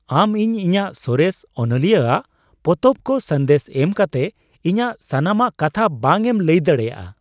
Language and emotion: Santali, surprised